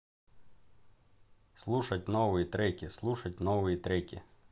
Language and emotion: Russian, neutral